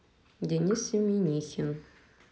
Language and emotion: Russian, neutral